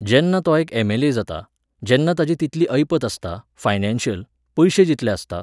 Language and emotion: Goan Konkani, neutral